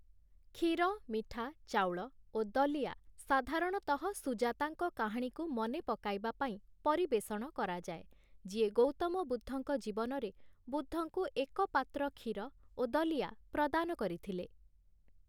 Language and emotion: Odia, neutral